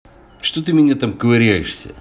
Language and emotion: Russian, angry